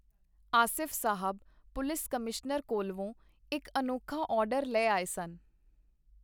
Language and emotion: Punjabi, neutral